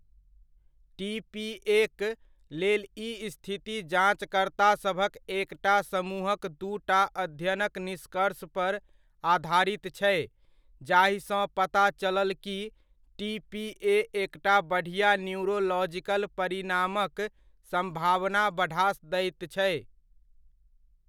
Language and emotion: Maithili, neutral